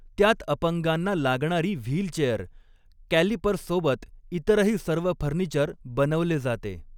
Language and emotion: Marathi, neutral